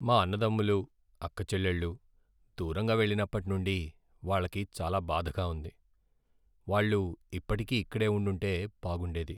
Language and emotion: Telugu, sad